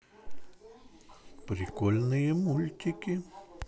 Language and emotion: Russian, positive